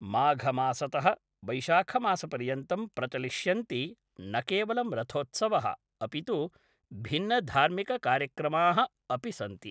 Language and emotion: Sanskrit, neutral